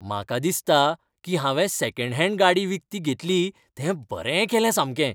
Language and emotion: Goan Konkani, happy